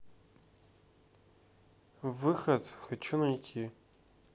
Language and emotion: Russian, neutral